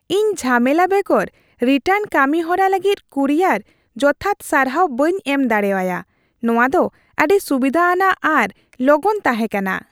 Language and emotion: Santali, happy